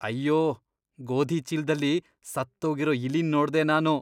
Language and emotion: Kannada, disgusted